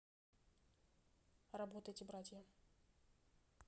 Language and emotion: Russian, neutral